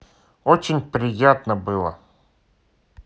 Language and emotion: Russian, neutral